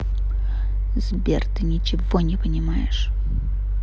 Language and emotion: Russian, angry